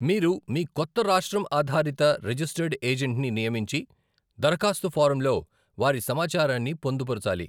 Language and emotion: Telugu, neutral